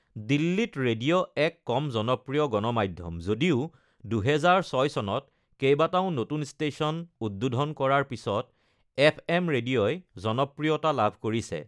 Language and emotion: Assamese, neutral